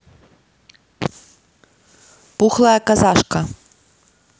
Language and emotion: Russian, neutral